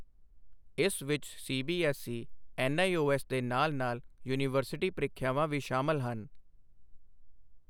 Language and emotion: Punjabi, neutral